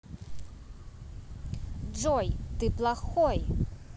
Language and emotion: Russian, angry